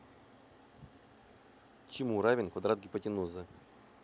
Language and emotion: Russian, neutral